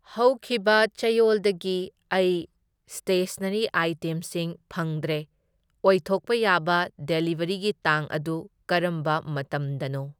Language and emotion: Manipuri, neutral